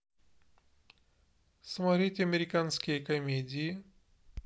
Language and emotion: Russian, neutral